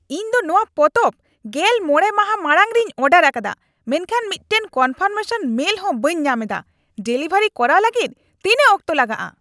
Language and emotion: Santali, angry